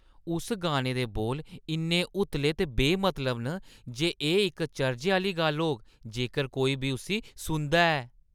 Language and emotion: Dogri, disgusted